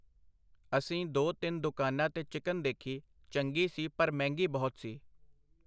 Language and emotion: Punjabi, neutral